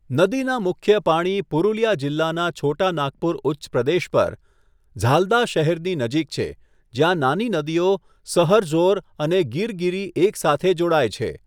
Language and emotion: Gujarati, neutral